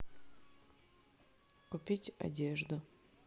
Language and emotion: Russian, neutral